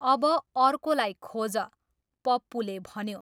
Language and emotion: Nepali, neutral